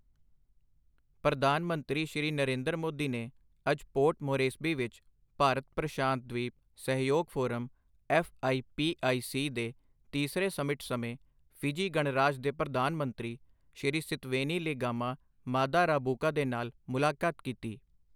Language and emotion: Punjabi, neutral